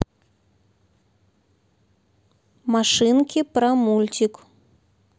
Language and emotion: Russian, neutral